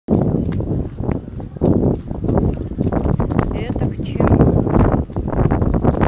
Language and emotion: Russian, neutral